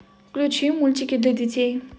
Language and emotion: Russian, neutral